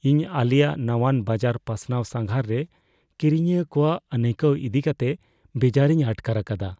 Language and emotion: Santali, fearful